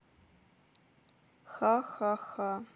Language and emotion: Russian, neutral